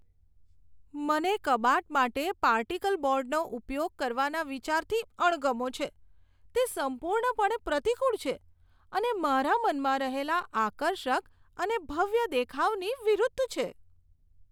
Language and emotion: Gujarati, disgusted